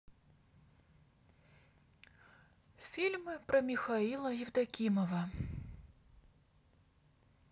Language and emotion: Russian, sad